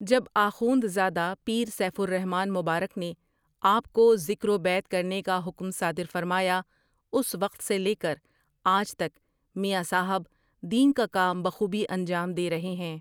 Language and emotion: Urdu, neutral